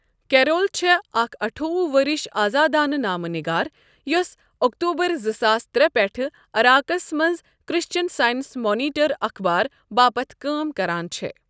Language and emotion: Kashmiri, neutral